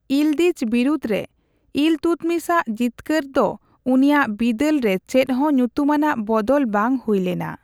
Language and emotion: Santali, neutral